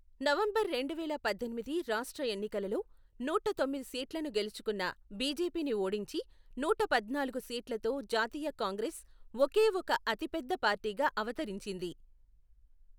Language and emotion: Telugu, neutral